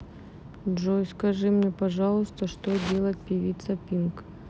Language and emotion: Russian, neutral